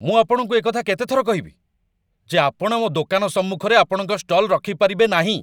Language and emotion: Odia, angry